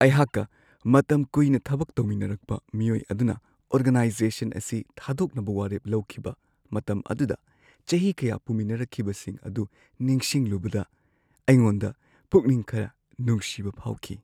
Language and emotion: Manipuri, sad